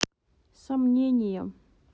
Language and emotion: Russian, neutral